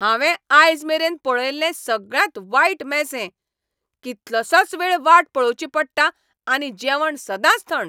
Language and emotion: Goan Konkani, angry